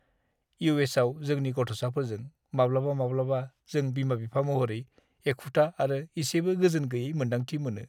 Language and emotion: Bodo, sad